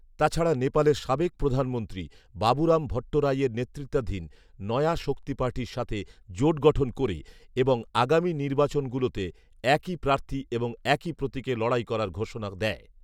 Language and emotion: Bengali, neutral